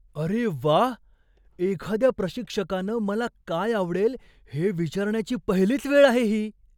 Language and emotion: Marathi, surprised